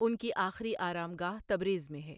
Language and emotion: Urdu, neutral